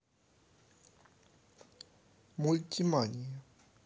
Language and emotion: Russian, neutral